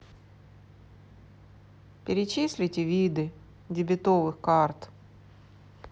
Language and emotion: Russian, sad